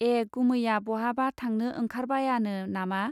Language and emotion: Bodo, neutral